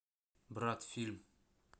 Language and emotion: Russian, neutral